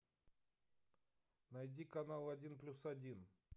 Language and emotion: Russian, neutral